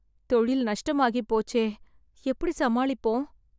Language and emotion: Tamil, sad